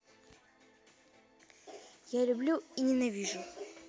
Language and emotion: Russian, neutral